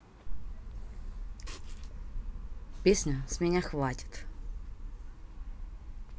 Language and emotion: Russian, neutral